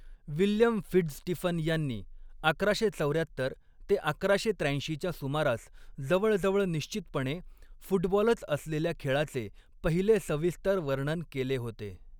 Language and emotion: Marathi, neutral